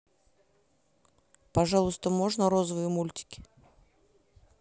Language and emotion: Russian, neutral